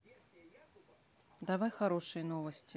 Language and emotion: Russian, neutral